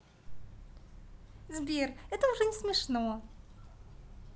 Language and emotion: Russian, positive